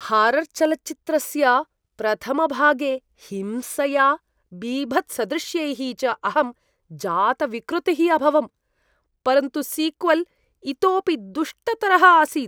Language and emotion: Sanskrit, disgusted